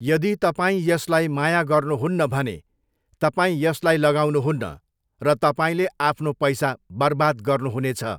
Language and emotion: Nepali, neutral